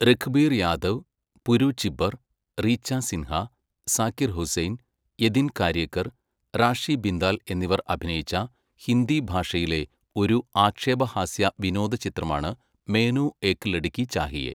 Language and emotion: Malayalam, neutral